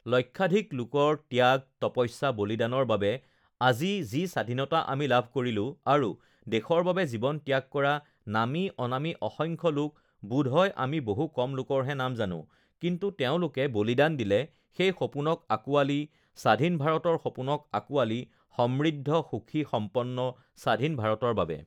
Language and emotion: Assamese, neutral